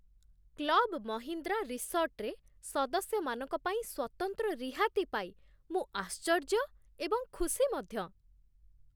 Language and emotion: Odia, surprised